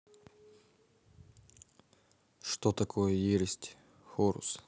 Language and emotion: Russian, neutral